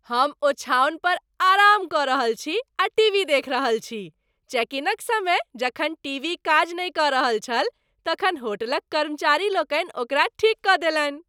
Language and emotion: Maithili, happy